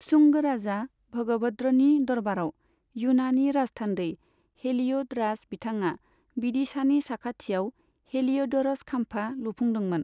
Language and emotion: Bodo, neutral